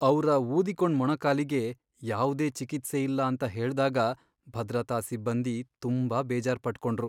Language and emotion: Kannada, sad